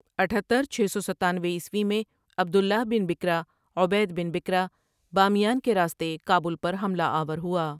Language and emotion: Urdu, neutral